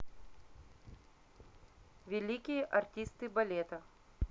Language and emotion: Russian, neutral